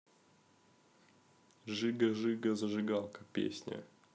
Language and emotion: Russian, neutral